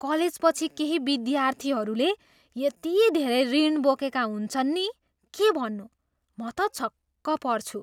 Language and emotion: Nepali, surprised